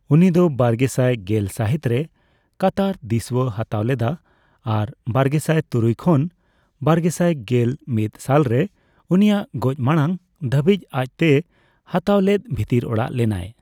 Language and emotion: Santali, neutral